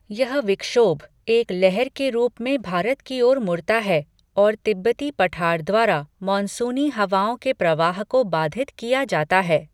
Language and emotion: Hindi, neutral